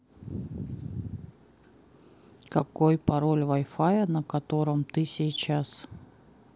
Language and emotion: Russian, neutral